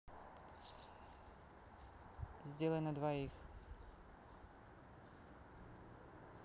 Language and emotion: Russian, neutral